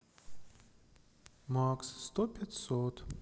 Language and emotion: Russian, sad